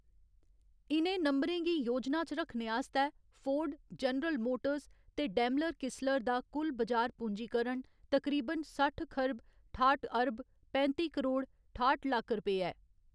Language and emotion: Dogri, neutral